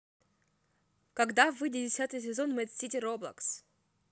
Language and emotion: Russian, neutral